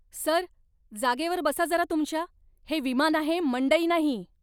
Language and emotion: Marathi, angry